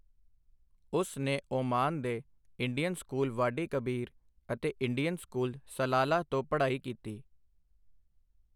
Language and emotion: Punjabi, neutral